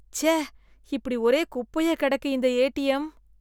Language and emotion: Tamil, disgusted